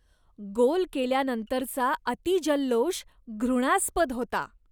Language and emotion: Marathi, disgusted